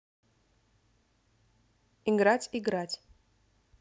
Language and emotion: Russian, neutral